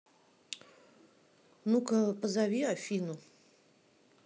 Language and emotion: Russian, neutral